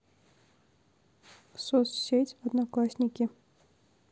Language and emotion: Russian, neutral